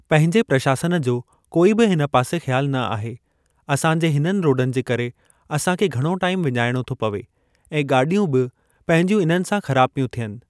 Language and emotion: Sindhi, neutral